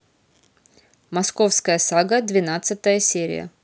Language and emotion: Russian, neutral